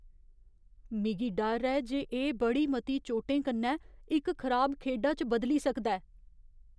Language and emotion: Dogri, fearful